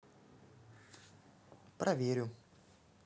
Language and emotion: Russian, neutral